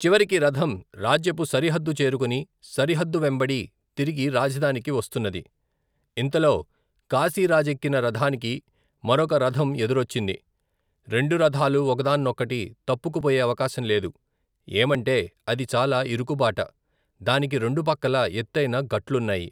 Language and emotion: Telugu, neutral